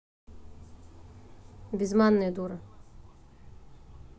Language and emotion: Russian, neutral